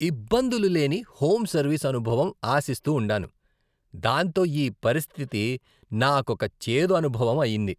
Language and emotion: Telugu, disgusted